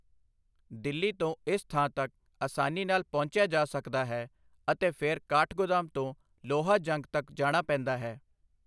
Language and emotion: Punjabi, neutral